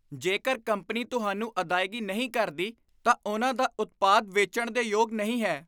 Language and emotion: Punjabi, disgusted